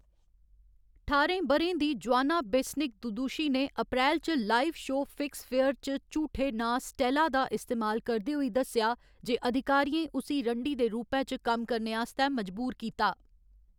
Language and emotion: Dogri, neutral